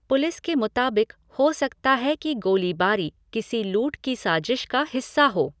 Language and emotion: Hindi, neutral